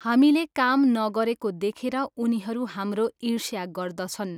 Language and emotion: Nepali, neutral